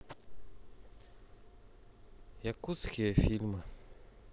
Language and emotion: Russian, sad